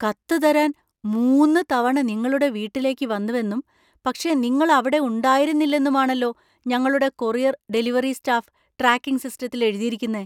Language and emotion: Malayalam, surprised